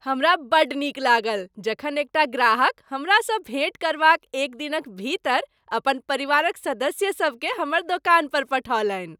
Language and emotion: Maithili, happy